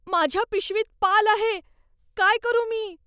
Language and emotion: Marathi, fearful